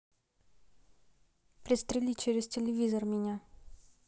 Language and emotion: Russian, neutral